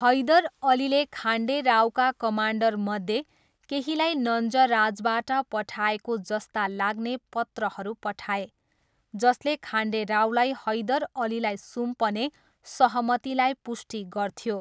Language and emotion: Nepali, neutral